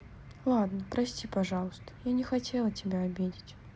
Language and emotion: Russian, sad